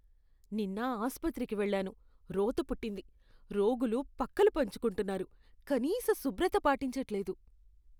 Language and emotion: Telugu, disgusted